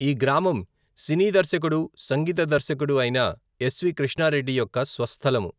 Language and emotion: Telugu, neutral